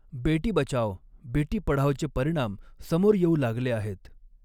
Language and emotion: Marathi, neutral